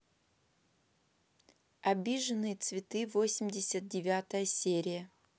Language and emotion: Russian, neutral